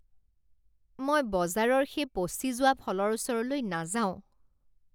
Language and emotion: Assamese, disgusted